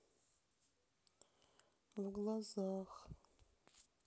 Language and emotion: Russian, sad